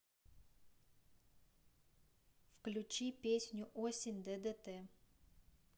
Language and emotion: Russian, neutral